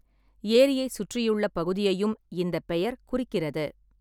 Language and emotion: Tamil, neutral